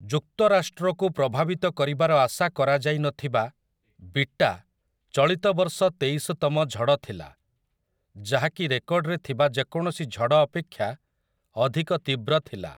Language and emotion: Odia, neutral